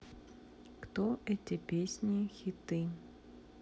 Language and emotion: Russian, neutral